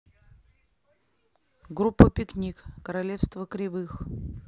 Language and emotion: Russian, neutral